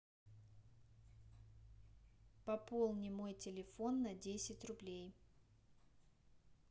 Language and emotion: Russian, neutral